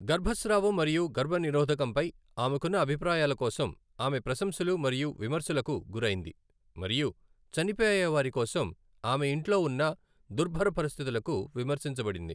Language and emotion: Telugu, neutral